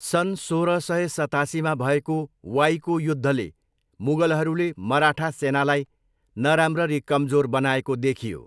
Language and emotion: Nepali, neutral